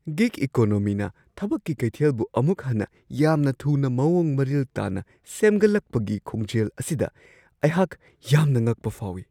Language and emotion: Manipuri, surprised